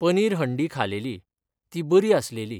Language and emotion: Goan Konkani, neutral